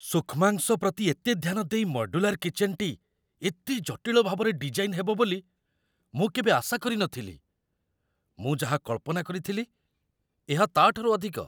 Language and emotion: Odia, surprised